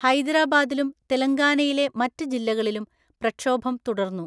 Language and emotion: Malayalam, neutral